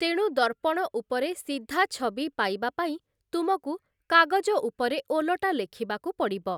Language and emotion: Odia, neutral